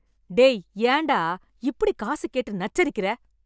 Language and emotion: Tamil, angry